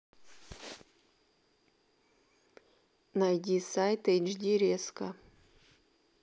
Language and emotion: Russian, neutral